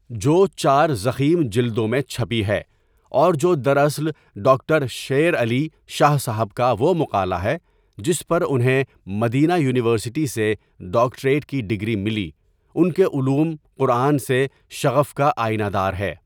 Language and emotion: Urdu, neutral